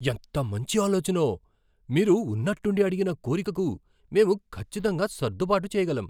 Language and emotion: Telugu, surprised